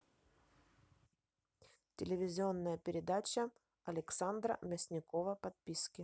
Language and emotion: Russian, neutral